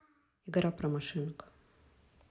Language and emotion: Russian, neutral